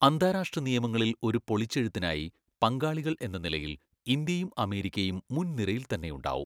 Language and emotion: Malayalam, neutral